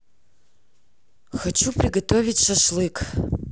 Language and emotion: Russian, neutral